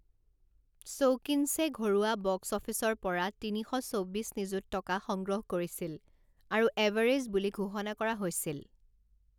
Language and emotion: Assamese, neutral